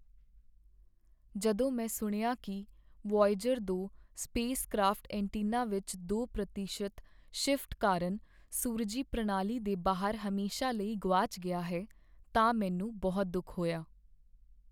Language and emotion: Punjabi, sad